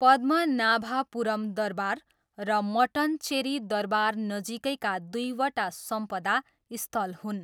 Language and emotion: Nepali, neutral